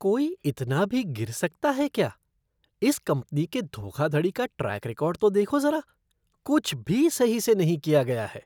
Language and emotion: Hindi, disgusted